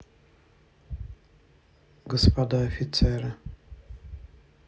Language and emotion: Russian, sad